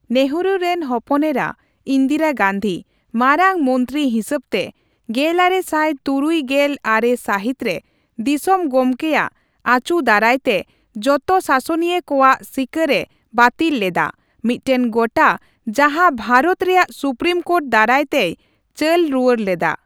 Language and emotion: Santali, neutral